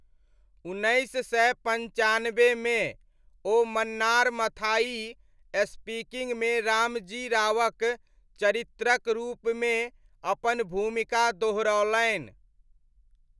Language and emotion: Maithili, neutral